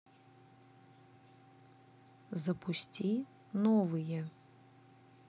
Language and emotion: Russian, neutral